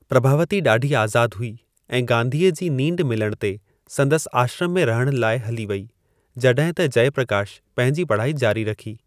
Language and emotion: Sindhi, neutral